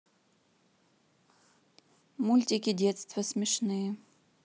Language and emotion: Russian, neutral